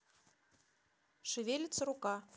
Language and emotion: Russian, neutral